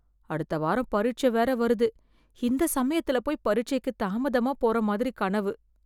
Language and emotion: Tamil, fearful